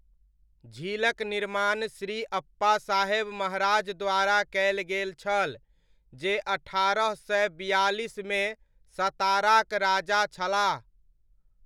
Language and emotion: Maithili, neutral